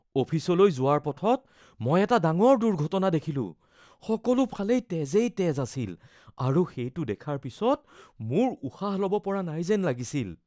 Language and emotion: Assamese, fearful